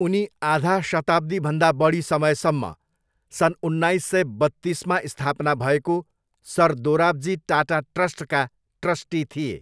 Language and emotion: Nepali, neutral